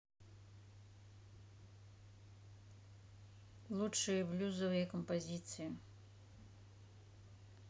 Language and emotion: Russian, neutral